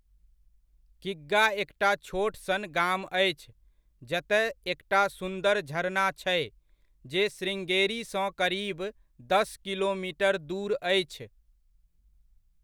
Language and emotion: Maithili, neutral